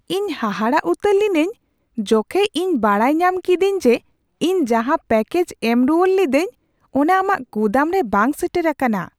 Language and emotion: Santali, surprised